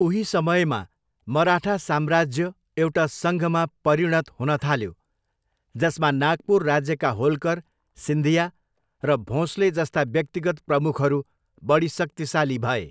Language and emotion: Nepali, neutral